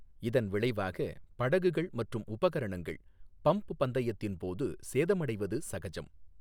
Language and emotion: Tamil, neutral